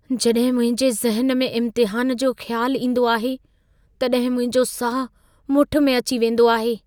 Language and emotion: Sindhi, fearful